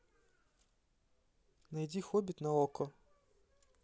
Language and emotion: Russian, neutral